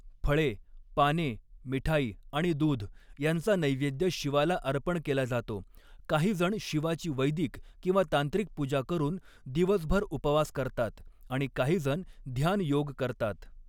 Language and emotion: Marathi, neutral